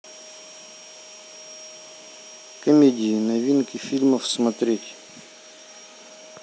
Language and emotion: Russian, neutral